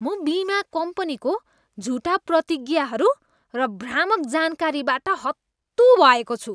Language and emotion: Nepali, disgusted